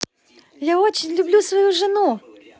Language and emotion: Russian, positive